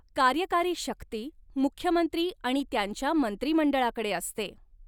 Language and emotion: Marathi, neutral